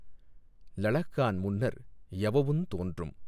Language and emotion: Tamil, neutral